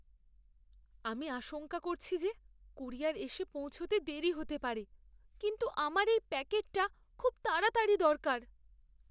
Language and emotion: Bengali, fearful